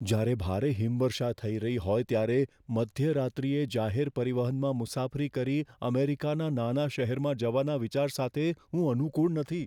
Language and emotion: Gujarati, fearful